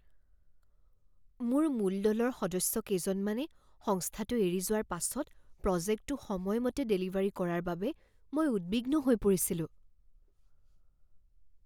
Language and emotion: Assamese, fearful